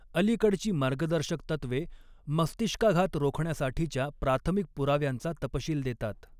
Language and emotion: Marathi, neutral